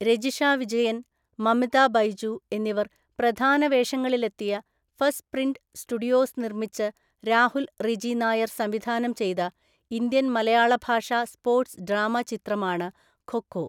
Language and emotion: Malayalam, neutral